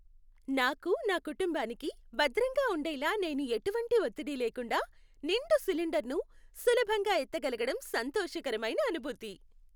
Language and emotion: Telugu, happy